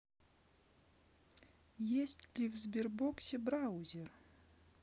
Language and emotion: Russian, neutral